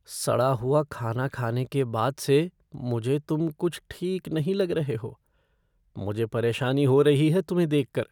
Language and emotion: Hindi, fearful